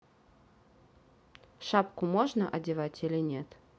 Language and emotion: Russian, neutral